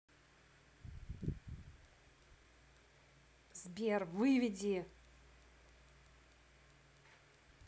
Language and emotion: Russian, angry